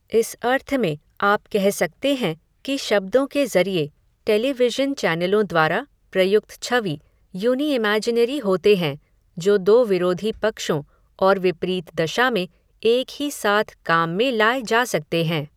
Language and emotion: Hindi, neutral